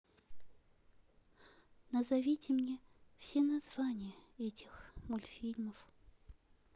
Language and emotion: Russian, neutral